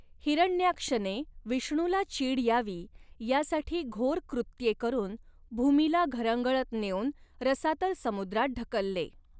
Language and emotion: Marathi, neutral